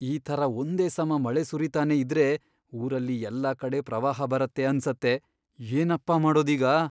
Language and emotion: Kannada, fearful